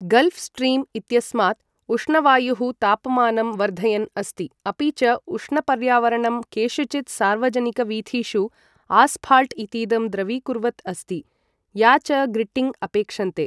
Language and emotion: Sanskrit, neutral